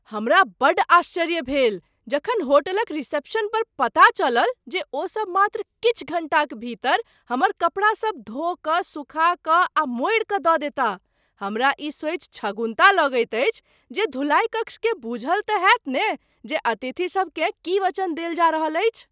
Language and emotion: Maithili, surprised